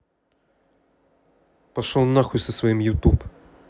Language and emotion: Russian, angry